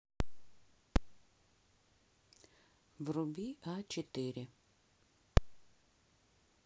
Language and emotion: Russian, neutral